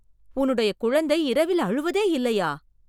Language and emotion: Tamil, surprised